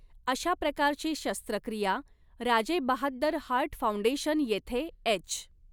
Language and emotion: Marathi, neutral